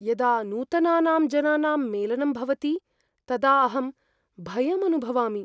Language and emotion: Sanskrit, fearful